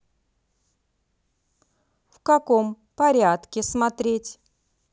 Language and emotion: Russian, neutral